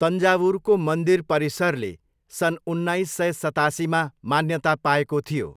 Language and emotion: Nepali, neutral